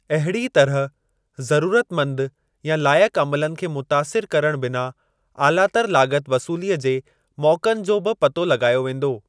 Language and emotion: Sindhi, neutral